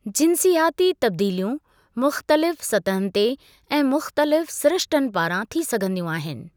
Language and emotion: Sindhi, neutral